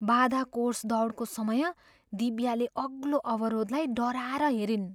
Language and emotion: Nepali, fearful